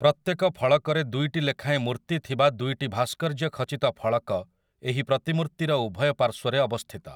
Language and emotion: Odia, neutral